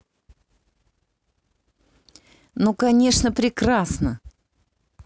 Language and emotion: Russian, positive